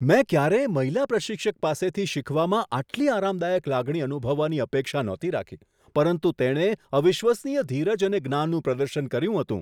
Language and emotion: Gujarati, surprised